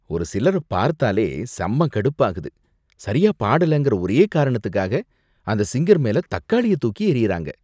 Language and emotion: Tamil, disgusted